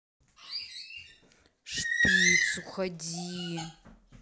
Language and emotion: Russian, angry